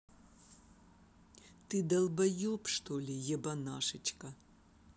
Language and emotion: Russian, angry